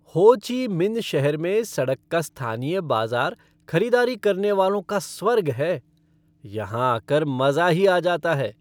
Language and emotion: Hindi, happy